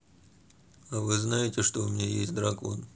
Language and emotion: Russian, neutral